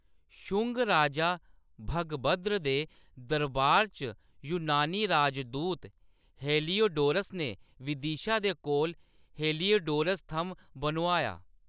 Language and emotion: Dogri, neutral